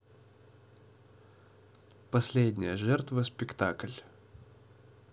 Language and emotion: Russian, neutral